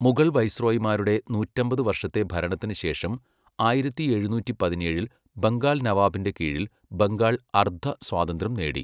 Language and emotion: Malayalam, neutral